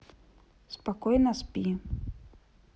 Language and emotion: Russian, neutral